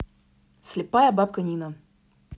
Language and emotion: Russian, neutral